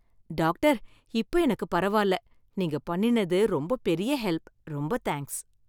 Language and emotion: Tamil, happy